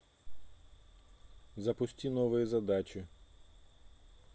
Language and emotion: Russian, neutral